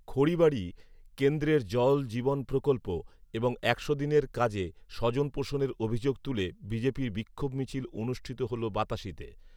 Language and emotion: Bengali, neutral